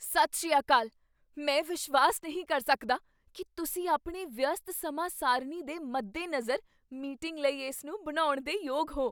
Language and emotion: Punjabi, surprised